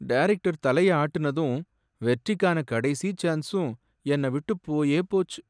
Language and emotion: Tamil, sad